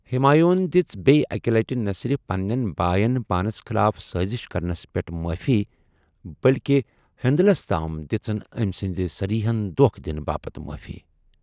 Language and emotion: Kashmiri, neutral